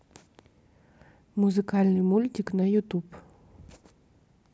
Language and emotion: Russian, neutral